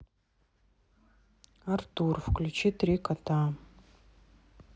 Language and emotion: Russian, neutral